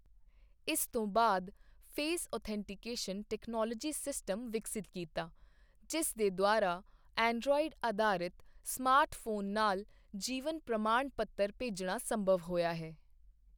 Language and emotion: Punjabi, neutral